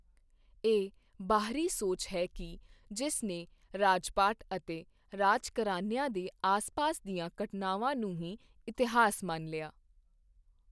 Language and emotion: Punjabi, neutral